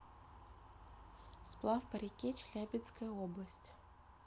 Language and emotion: Russian, neutral